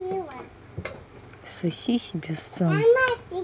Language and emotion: Russian, angry